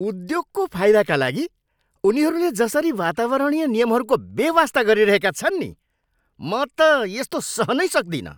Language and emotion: Nepali, angry